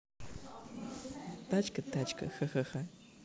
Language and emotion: Russian, neutral